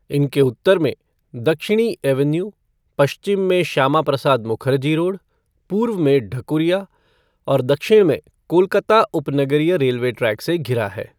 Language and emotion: Hindi, neutral